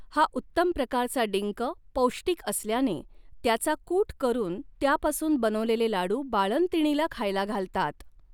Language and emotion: Marathi, neutral